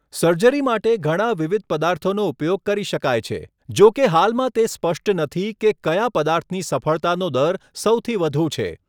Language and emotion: Gujarati, neutral